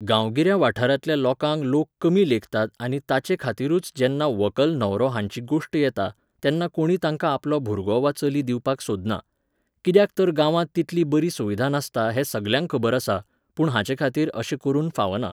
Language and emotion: Goan Konkani, neutral